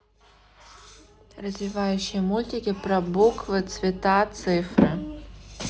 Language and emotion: Russian, neutral